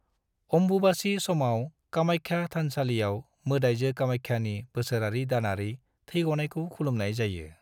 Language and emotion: Bodo, neutral